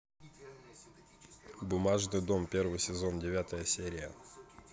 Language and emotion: Russian, neutral